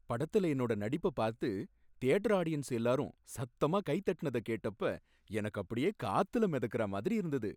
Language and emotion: Tamil, happy